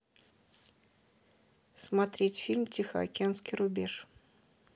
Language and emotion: Russian, neutral